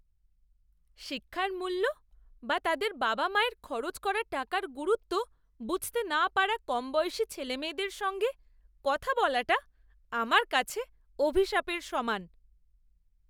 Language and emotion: Bengali, disgusted